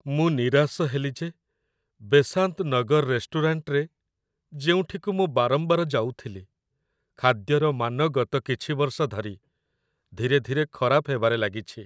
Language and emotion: Odia, sad